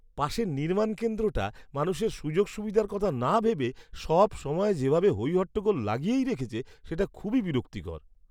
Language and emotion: Bengali, disgusted